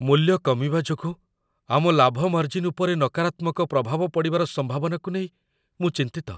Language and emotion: Odia, fearful